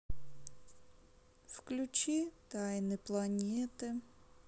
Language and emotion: Russian, sad